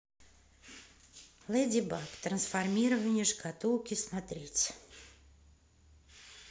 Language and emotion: Russian, neutral